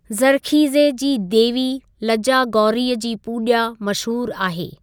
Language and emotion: Sindhi, neutral